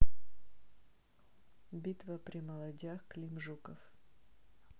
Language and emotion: Russian, neutral